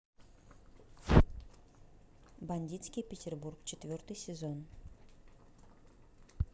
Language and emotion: Russian, neutral